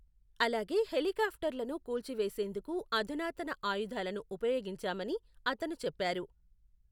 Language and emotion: Telugu, neutral